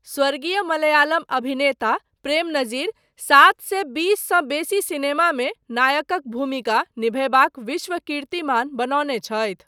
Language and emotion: Maithili, neutral